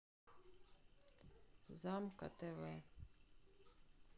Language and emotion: Russian, sad